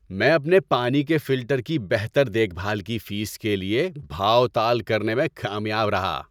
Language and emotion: Urdu, happy